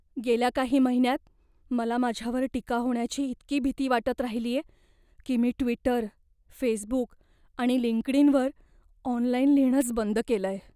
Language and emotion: Marathi, fearful